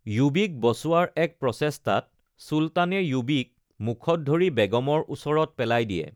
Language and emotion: Assamese, neutral